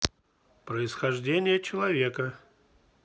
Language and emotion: Russian, neutral